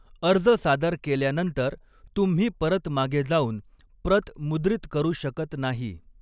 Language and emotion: Marathi, neutral